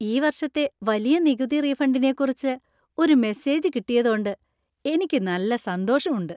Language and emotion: Malayalam, happy